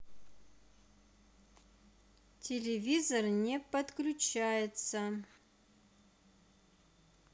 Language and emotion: Russian, neutral